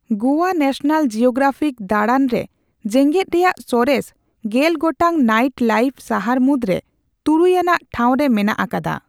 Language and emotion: Santali, neutral